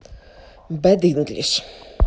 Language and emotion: Russian, neutral